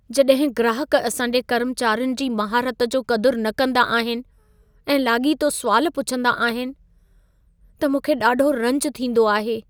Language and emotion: Sindhi, sad